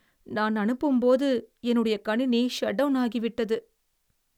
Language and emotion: Tamil, sad